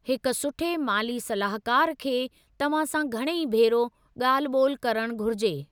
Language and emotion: Sindhi, neutral